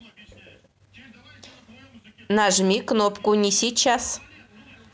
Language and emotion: Russian, neutral